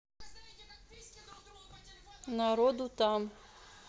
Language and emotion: Russian, neutral